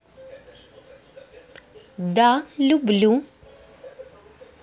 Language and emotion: Russian, positive